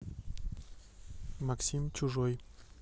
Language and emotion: Russian, neutral